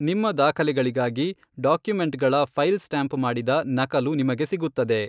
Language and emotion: Kannada, neutral